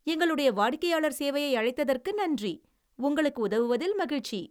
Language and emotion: Tamil, happy